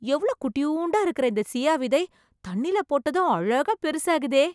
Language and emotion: Tamil, surprised